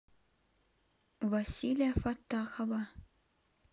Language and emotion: Russian, neutral